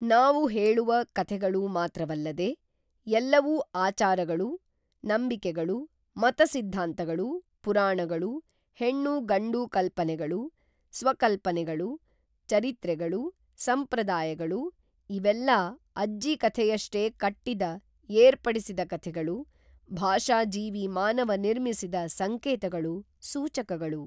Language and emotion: Kannada, neutral